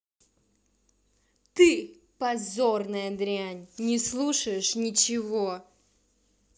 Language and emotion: Russian, angry